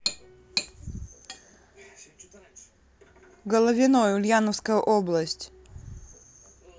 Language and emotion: Russian, neutral